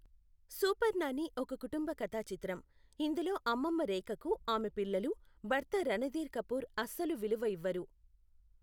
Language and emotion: Telugu, neutral